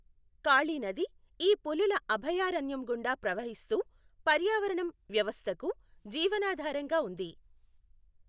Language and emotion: Telugu, neutral